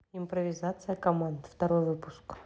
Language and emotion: Russian, neutral